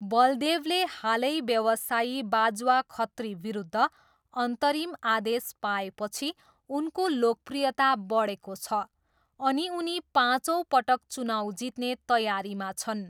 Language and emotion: Nepali, neutral